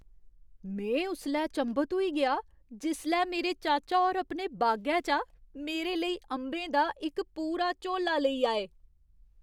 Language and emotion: Dogri, surprised